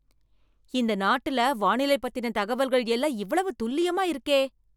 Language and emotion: Tamil, surprised